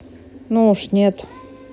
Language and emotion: Russian, neutral